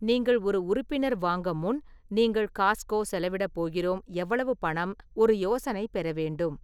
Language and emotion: Tamil, neutral